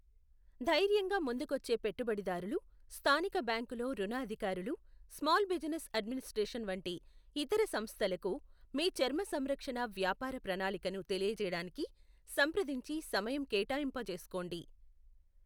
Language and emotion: Telugu, neutral